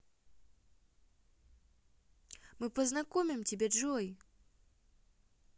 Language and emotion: Russian, positive